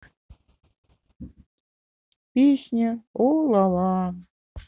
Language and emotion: Russian, sad